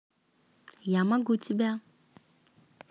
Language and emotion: Russian, positive